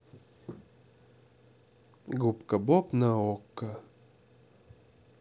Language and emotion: Russian, neutral